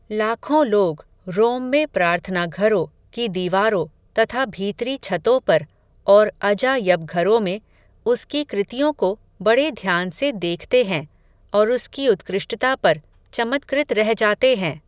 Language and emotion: Hindi, neutral